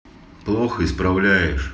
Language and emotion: Russian, angry